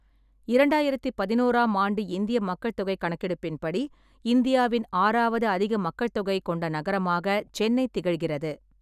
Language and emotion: Tamil, neutral